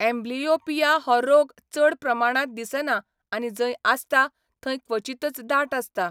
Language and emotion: Goan Konkani, neutral